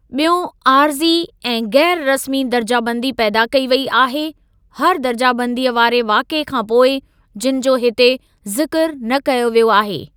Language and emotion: Sindhi, neutral